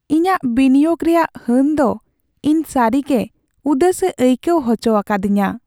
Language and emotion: Santali, sad